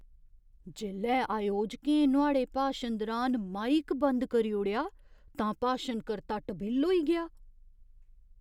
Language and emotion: Dogri, surprised